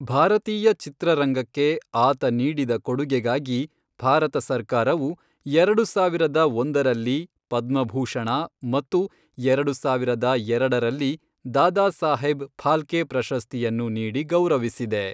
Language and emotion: Kannada, neutral